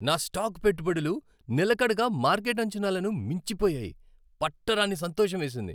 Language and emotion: Telugu, happy